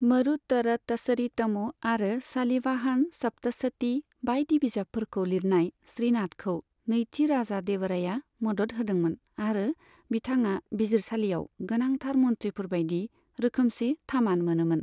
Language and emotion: Bodo, neutral